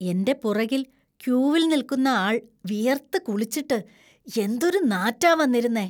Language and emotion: Malayalam, disgusted